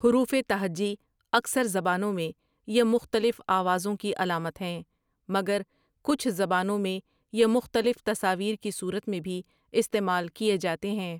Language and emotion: Urdu, neutral